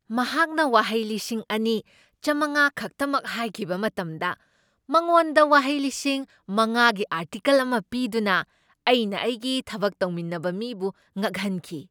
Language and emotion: Manipuri, surprised